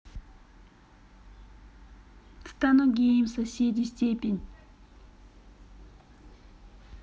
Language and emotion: Russian, neutral